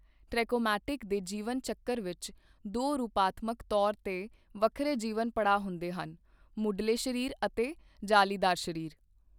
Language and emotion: Punjabi, neutral